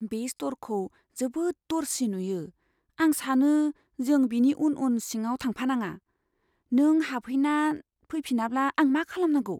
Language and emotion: Bodo, fearful